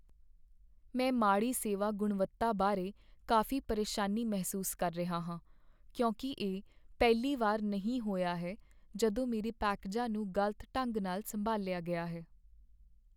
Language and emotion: Punjabi, sad